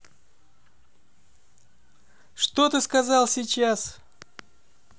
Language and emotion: Russian, angry